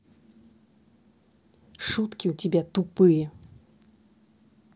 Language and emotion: Russian, angry